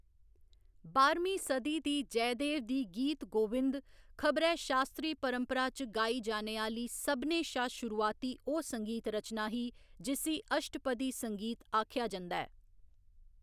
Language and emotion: Dogri, neutral